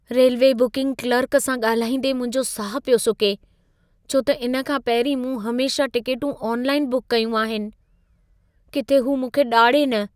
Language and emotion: Sindhi, fearful